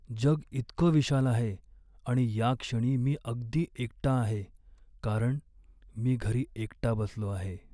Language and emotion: Marathi, sad